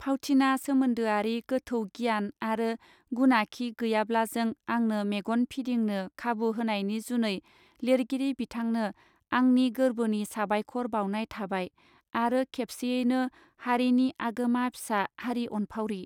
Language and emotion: Bodo, neutral